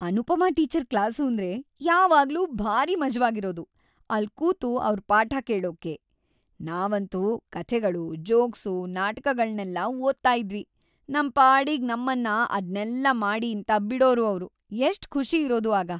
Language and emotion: Kannada, happy